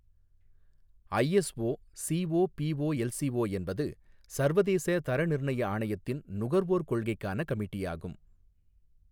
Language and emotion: Tamil, neutral